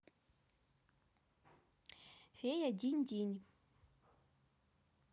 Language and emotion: Russian, positive